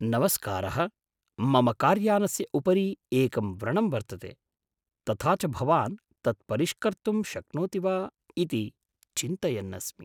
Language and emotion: Sanskrit, surprised